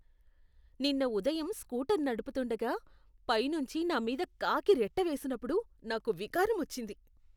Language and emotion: Telugu, disgusted